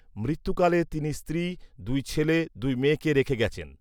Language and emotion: Bengali, neutral